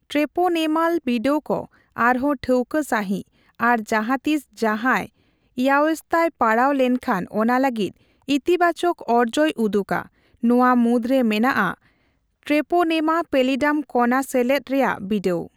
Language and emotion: Santali, neutral